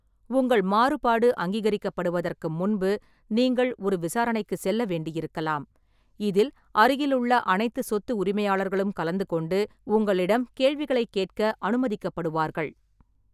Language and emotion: Tamil, neutral